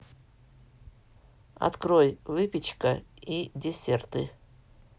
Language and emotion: Russian, neutral